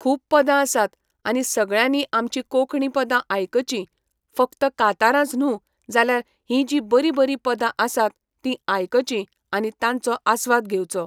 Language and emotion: Goan Konkani, neutral